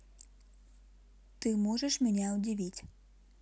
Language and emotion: Russian, neutral